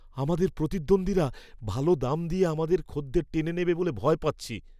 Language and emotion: Bengali, fearful